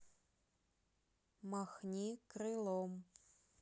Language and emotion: Russian, neutral